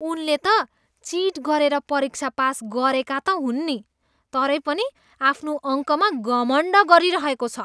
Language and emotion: Nepali, disgusted